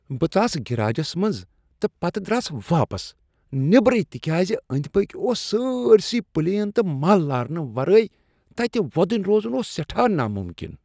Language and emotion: Kashmiri, disgusted